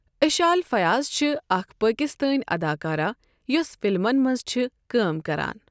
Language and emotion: Kashmiri, neutral